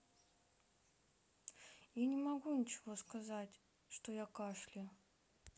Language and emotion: Russian, sad